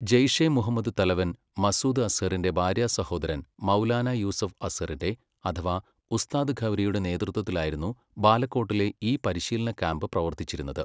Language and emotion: Malayalam, neutral